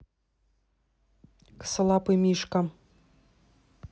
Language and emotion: Russian, neutral